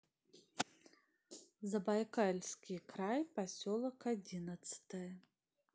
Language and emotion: Russian, neutral